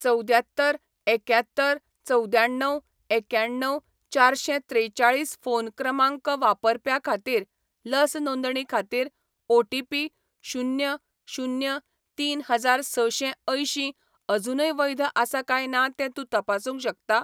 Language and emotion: Goan Konkani, neutral